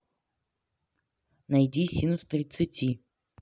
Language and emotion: Russian, neutral